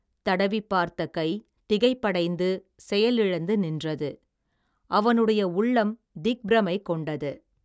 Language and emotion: Tamil, neutral